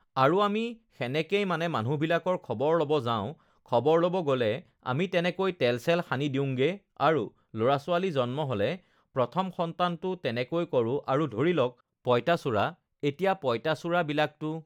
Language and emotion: Assamese, neutral